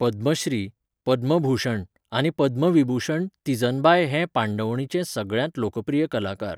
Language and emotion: Goan Konkani, neutral